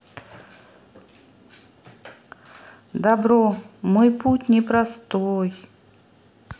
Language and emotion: Russian, neutral